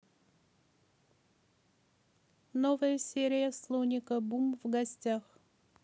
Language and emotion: Russian, neutral